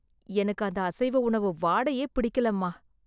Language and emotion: Tamil, disgusted